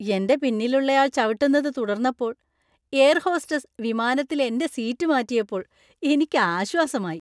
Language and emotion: Malayalam, happy